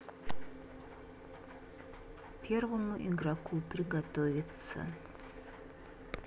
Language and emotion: Russian, neutral